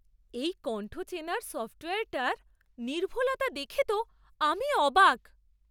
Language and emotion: Bengali, surprised